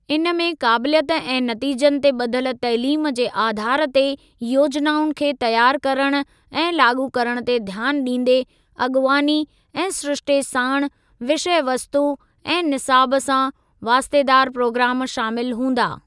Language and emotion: Sindhi, neutral